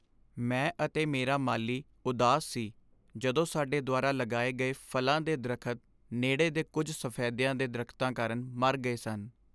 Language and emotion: Punjabi, sad